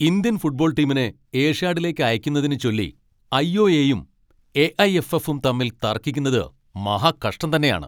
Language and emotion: Malayalam, angry